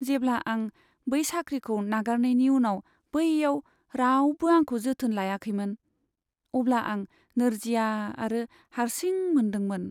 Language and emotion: Bodo, sad